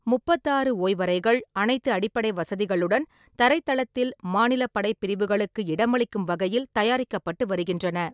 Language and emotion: Tamil, neutral